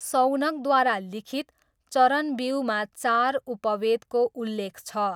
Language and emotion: Nepali, neutral